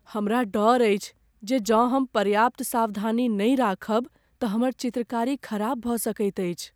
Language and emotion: Maithili, fearful